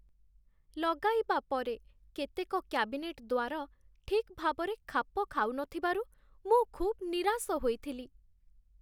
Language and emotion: Odia, sad